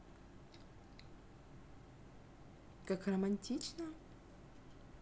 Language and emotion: Russian, neutral